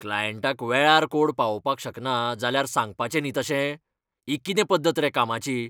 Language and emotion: Goan Konkani, angry